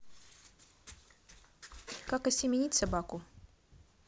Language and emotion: Russian, neutral